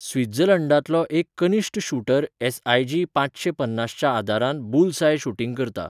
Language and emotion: Goan Konkani, neutral